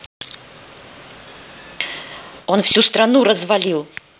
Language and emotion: Russian, angry